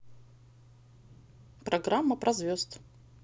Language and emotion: Russian, positive